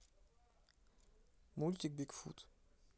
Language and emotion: Russian, neutral